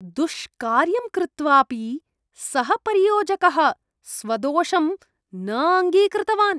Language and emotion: Sanskrit, disgusted